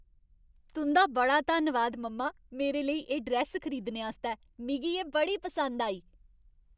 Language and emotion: Dogri, happy